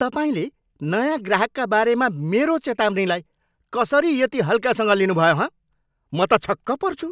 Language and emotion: Nepali, angry